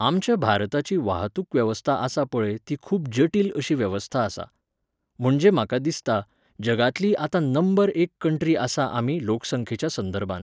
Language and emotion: Goan Konkani, neutral